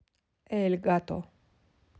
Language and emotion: Russian, neutral